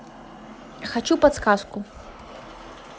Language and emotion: Russian, neutral